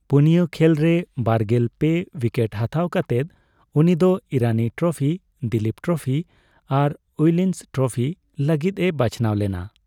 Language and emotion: Santali, neutral